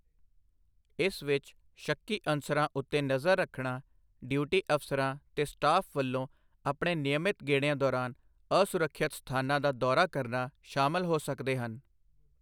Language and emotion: Punjabi, neutral